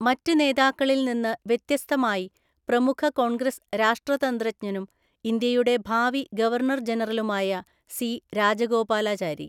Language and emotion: Malayalam, neutral